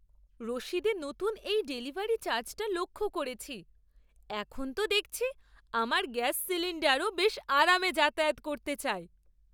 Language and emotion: Bengali, surprised